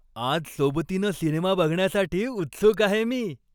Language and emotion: Marathi, happy